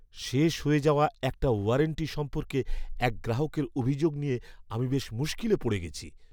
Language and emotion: Bengali, fearful